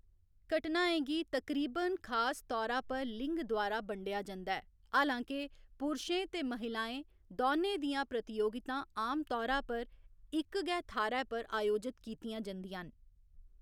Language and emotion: Dogri, neutral